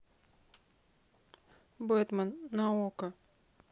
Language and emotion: Russian, neutral